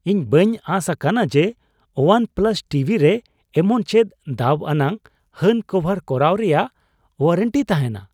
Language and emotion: Santali, surprised